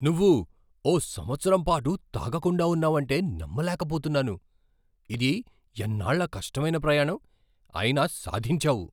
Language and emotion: Telugu, surprised